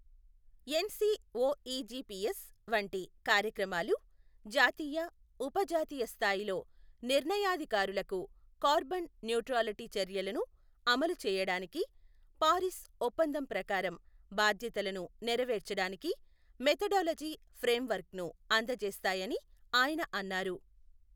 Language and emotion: Telugu, neutral